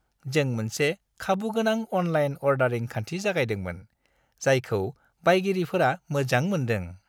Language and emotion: Bodo, happy